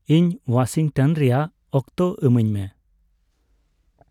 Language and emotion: Santali, neutral